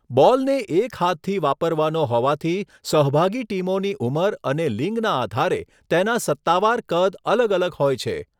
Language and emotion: Gujarati, neutral